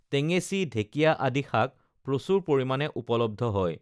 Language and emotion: Assamese, neutral